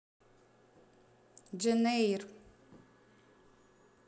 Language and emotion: Russian, neutral